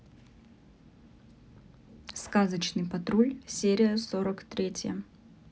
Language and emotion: Russian, neutral